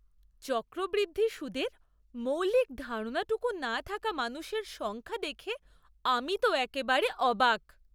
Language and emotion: Bengali, surprised